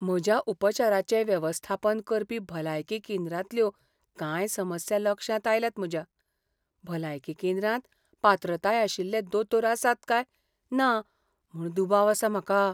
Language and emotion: Goan Konkani, fearful